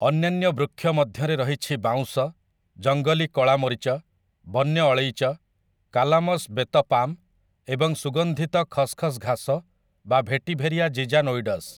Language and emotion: Odia, neutral